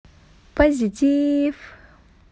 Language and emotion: Russian, positive